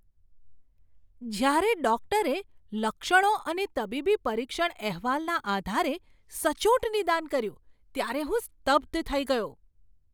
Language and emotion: Gujarati, surprised